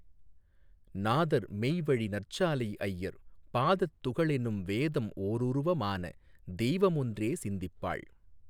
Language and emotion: Tamil, neutral